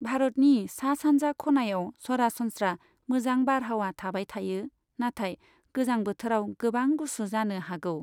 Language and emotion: Bodo, neutral